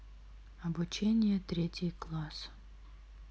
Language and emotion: Russian, neutral